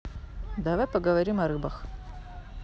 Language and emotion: Russian, neutral